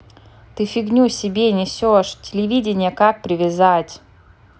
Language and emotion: Russian, angry